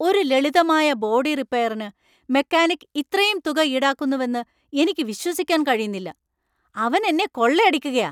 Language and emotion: Malayalam, angry